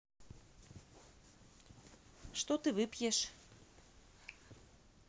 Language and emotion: Russian, neutral